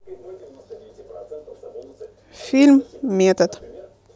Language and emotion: Russian, neutral